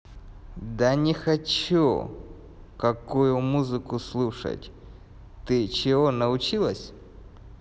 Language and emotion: Russian, angry